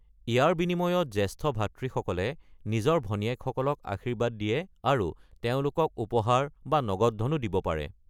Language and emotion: Assamese, neutral